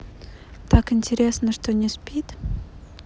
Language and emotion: Russian, neutral